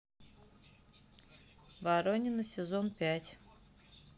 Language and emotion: Russian, neutral